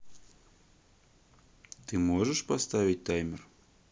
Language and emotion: Russian, neutral